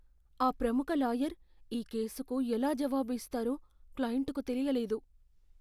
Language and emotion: Telugu, fearful